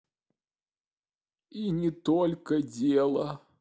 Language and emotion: Russian, neutral